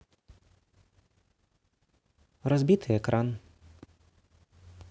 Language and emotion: Russian, neutral